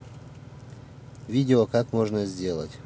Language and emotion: Russian, neutral